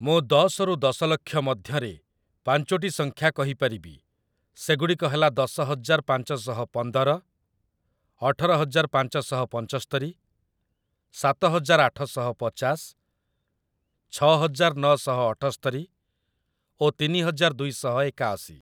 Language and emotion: Odia, neutral